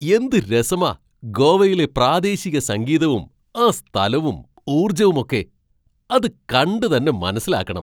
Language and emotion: Malayalam, surprised